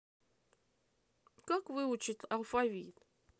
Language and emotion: Russian, neutral